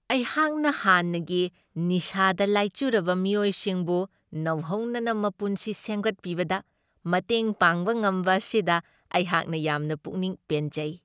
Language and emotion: Manipuri, happy